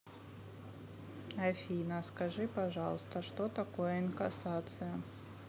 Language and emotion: Russian, neutral